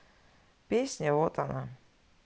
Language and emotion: Russian, neutral